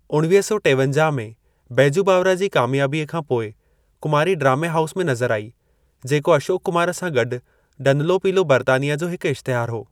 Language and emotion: Sindhi, neutral